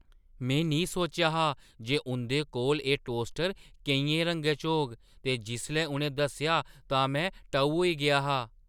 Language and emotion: Dogri, surprised